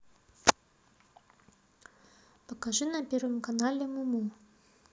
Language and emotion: Russian, neutral